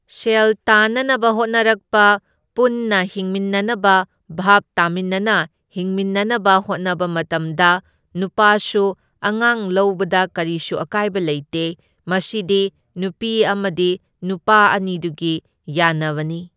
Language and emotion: Manipuri, neutral